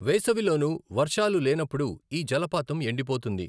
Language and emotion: Telugu, neutral